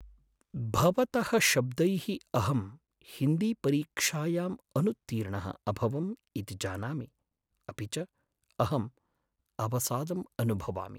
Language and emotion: Sanskrit, sad